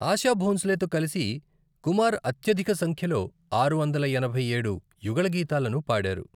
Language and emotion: Telugu, neutral